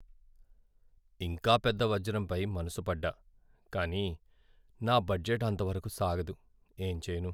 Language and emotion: Telugu, sad